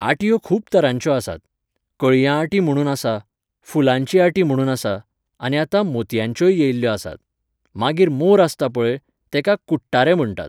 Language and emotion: Goan Konkani, neutral